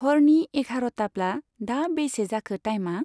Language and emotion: Bodo, neutral